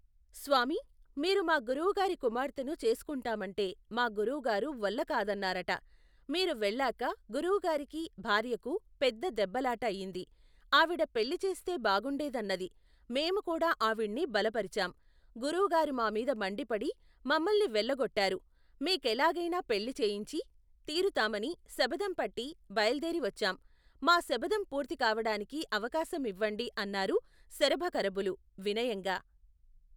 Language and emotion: Telugu, neutral